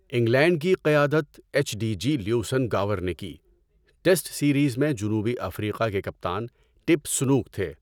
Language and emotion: Urdu, neutral